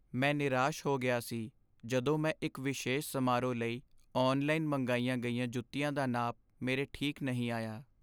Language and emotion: Punjabi, sad